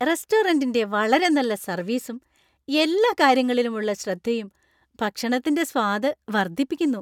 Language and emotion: Malayalam, happy